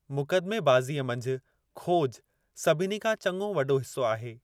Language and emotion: Sindhi, neutral